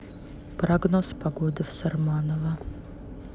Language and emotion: Russian, neutral